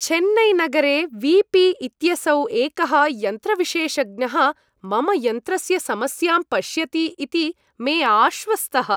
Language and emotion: Sanskrit, happy